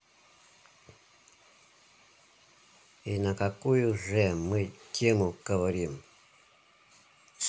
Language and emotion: Russian, neutral